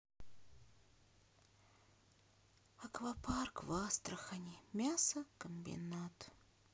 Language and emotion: Russian, sad